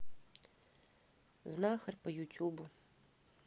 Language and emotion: Russian, neutral